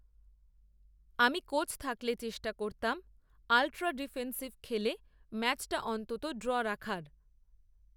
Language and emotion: Bengali, neutral